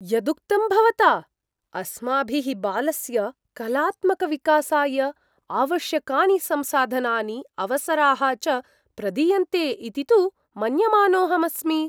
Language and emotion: Sanskrit, surprised